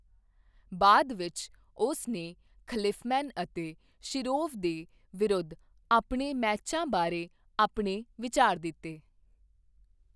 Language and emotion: Punjabi, neutral